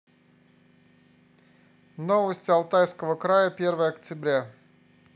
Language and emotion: Russian, neutral